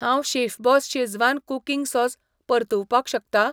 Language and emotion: Goan Konkani, neutral